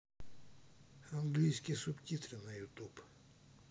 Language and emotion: Russian, neutral